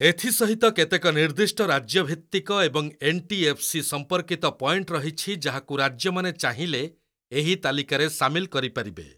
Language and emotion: Odia, neutral